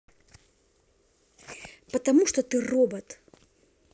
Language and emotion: Russian, angry